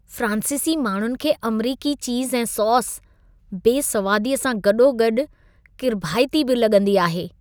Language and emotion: Sindhi, disgusted